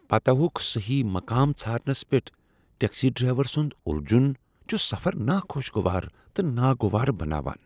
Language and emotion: Kashmiri, disgusted